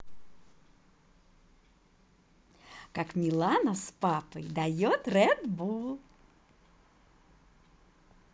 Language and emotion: Russian, positive